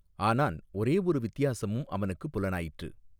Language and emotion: Tamil, neutral